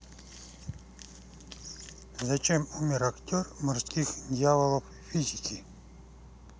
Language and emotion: Russian, neutral